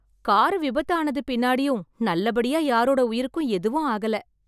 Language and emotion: Tamil, happy